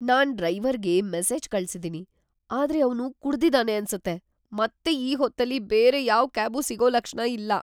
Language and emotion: Kannada, fearful